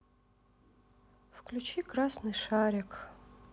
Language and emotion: Russian, sad